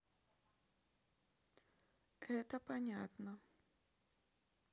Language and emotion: Russian, neutral